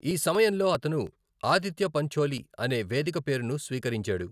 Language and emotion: Telugu, neutral